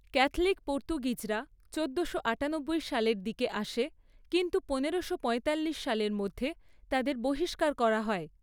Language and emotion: Bengali, neutral